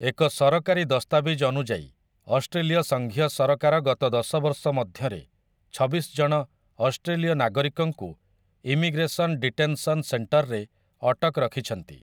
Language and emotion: Odia, neutral